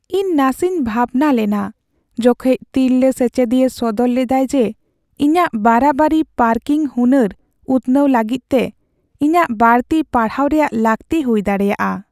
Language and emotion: Santali, sad